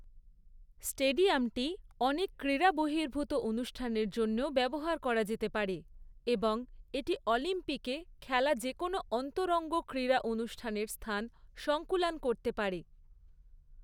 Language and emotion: Bengali, neutral